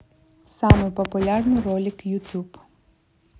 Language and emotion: Russian, neutral